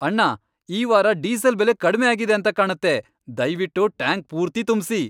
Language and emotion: Kannada, happy